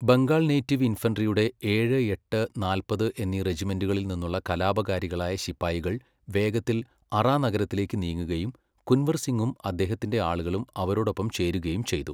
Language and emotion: Malayalam, neutral